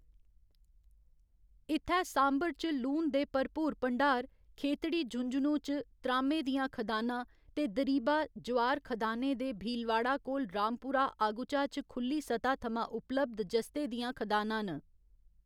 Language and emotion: Dogri, neutral